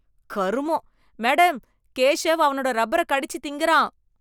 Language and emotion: Tamil, disgusted